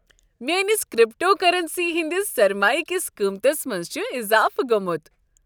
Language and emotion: Kashmiri, happy